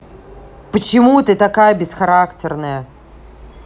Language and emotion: Russian, angry